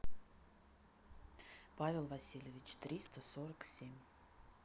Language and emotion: Russian, neutral